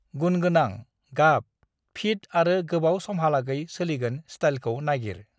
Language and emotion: Bodo, neutral